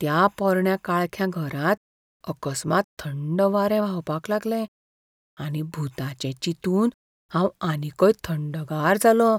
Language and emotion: Goan Konkani, fearful